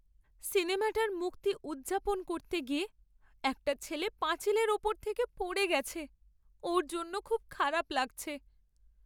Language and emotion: Bengali, sad